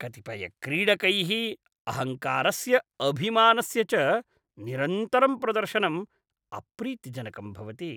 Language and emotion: Sanskrit, disgusted